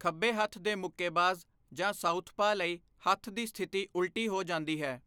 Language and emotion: Punjabi, neutral